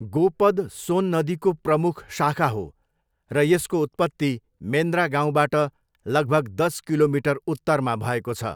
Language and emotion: Nepali, neutral